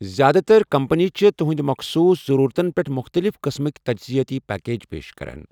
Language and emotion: Kashmiri, neutral